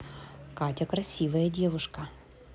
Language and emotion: Russian, positive